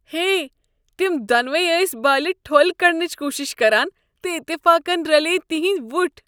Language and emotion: Kashmiri, disgusted